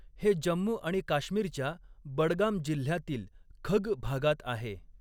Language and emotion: Marathi, neutral